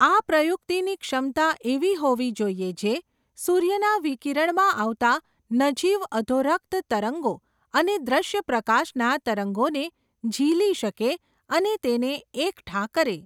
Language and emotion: Gujarati, neutral